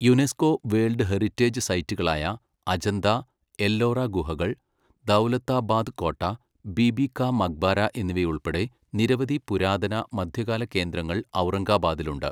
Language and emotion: Malayalam, neutral